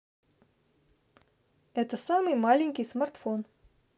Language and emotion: Russian, neutral